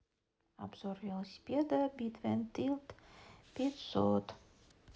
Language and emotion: Russian, neutral